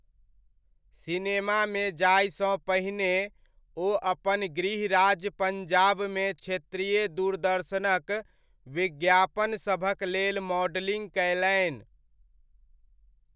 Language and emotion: Maithili, neutral